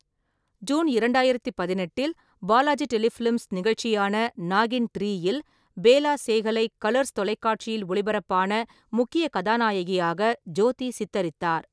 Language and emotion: Tamil, neutral